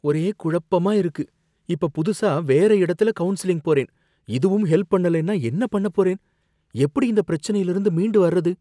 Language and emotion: Tamil, fearful